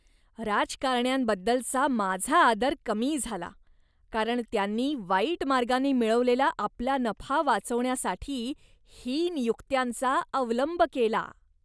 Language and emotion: Marathi, disgusted